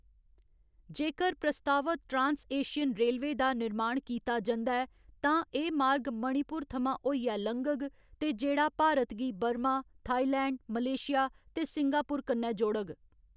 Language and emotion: Dogri, neutral